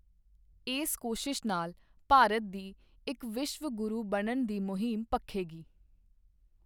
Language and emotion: Punjabi, neutral